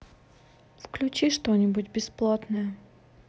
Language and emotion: Russian, neutral